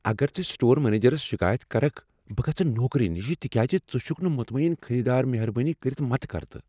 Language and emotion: Kashmiri, fearful